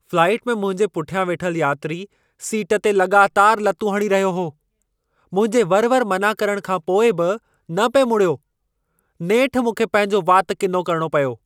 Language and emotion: Sindhi, angry